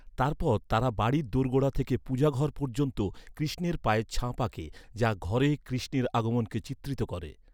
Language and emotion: Bengali, neutral